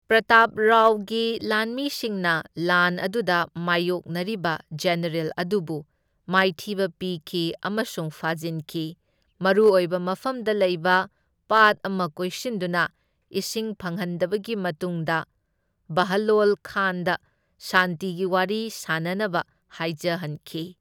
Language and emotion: Manipuri, neutral